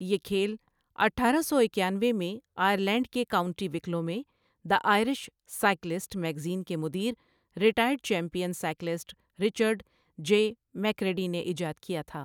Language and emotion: Urdu, neutral